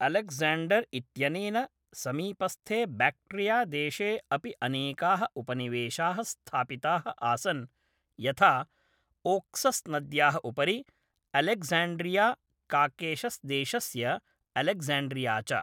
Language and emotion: Sanskrit, neutral